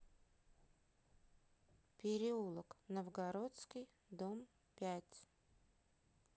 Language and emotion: Russian, neutral